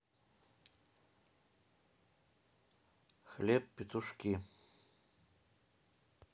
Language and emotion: Russian, neutral